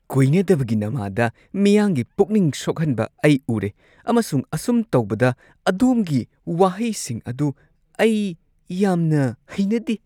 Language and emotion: Manipuri, disgusted